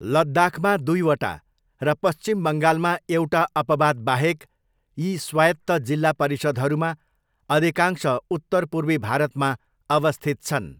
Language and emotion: Nepali, neutral